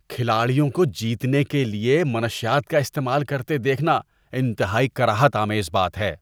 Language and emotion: Urdu, disgusted